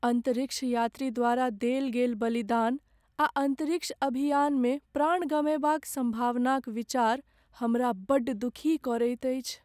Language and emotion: Maithili, sad